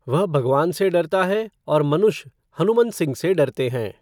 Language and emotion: Hindi, neutral